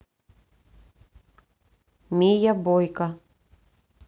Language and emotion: Russian, neutral